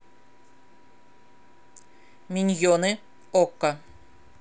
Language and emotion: Russian, neutral